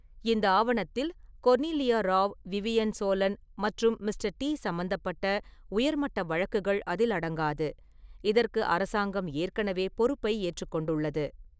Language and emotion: Tamil, neutral